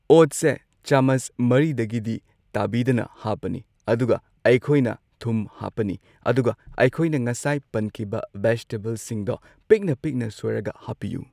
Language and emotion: Manipuri, neutral